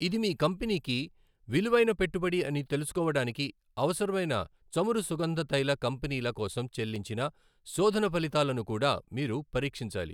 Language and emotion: Telugu, neutral